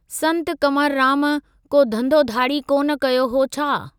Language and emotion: Sindhi, neutral